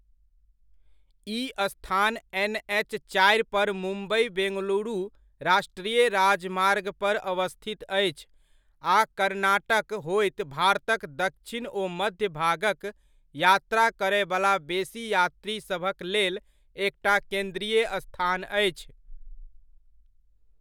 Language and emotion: Maithili, neutral